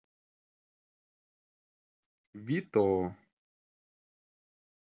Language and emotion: Russian, neutral